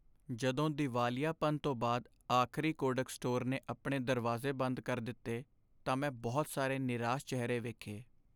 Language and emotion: Punjabi, sad